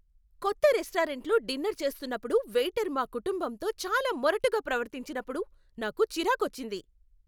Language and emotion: Telugu, angry